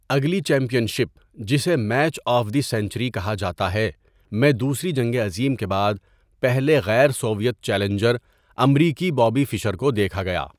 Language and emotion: Urdu, neutral